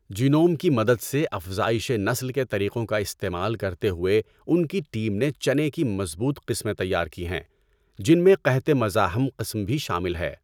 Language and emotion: Urdu, neutral